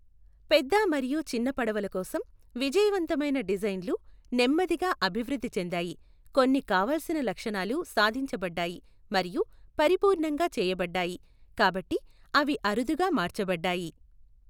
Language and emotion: Telugu, neutral